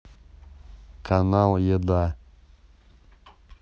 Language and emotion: Russian, neutral